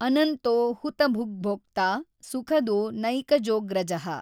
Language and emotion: Kannada, neutral